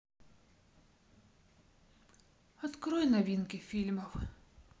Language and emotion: Russian, sad